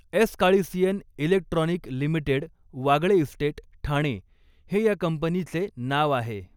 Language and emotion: Marathi, neutral